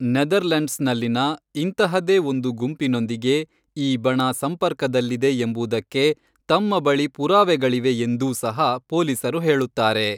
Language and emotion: Kannada, neutral